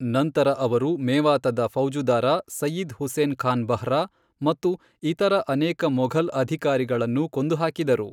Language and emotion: Kannada, neutral